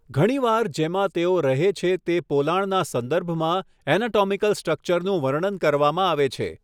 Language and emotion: Gujarati, neutral